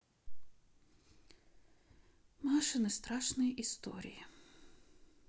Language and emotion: Russian, sad